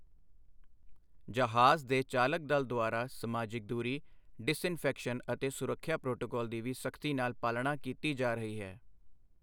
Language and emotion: Punjabi, neutral